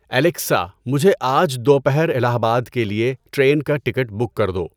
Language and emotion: Urdu, neutral